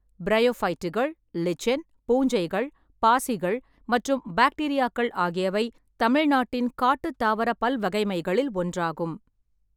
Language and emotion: Tamil, neutral